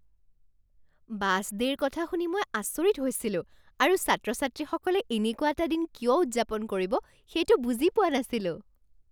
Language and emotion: Assamese, surprised